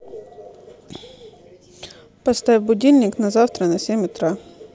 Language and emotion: Russian, neutral